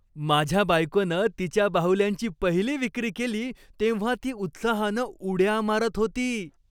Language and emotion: Marathi, happy